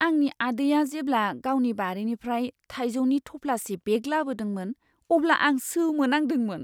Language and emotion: Bodo, surprised